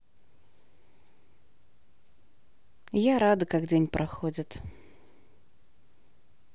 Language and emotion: Russian, positive